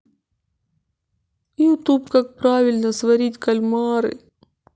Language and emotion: Russian, sad